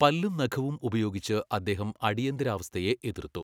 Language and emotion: Malayalam, neutral